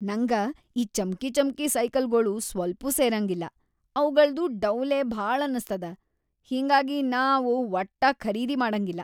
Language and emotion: Kannada, disgusted